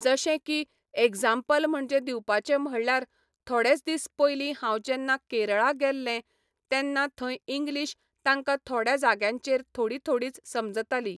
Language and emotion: Goan Konkani, neutral